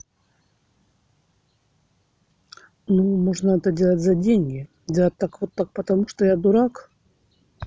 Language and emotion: Russian, neutral